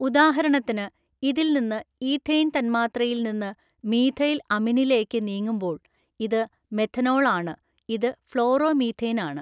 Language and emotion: Malayalam, neutral